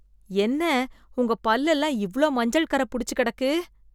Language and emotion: Tamil, disgusted